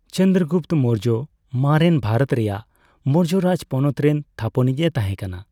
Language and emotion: Santali, neutral